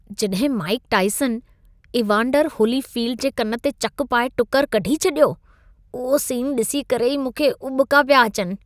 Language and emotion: Sindhi, disgusted